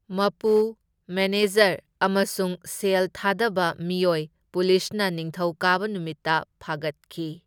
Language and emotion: Manipuri, neutral